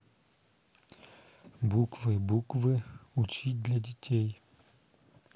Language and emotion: Russian, neutral